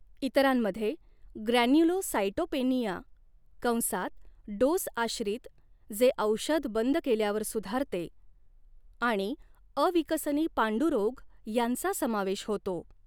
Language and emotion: Marathi, neutral